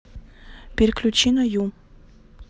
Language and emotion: Russian, neutral